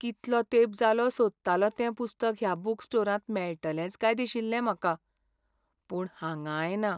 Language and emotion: Goan Konkani, sad